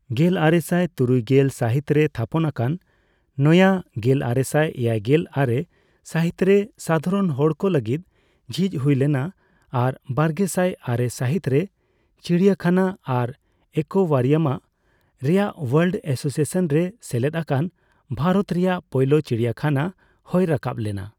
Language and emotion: Santali, neutral